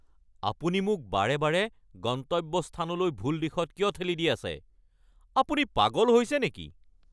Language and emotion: Assamese, angry